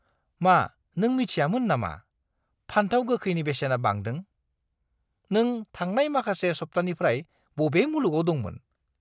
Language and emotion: Bodo, disgusted